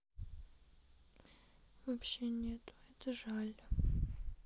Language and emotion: Russian, sad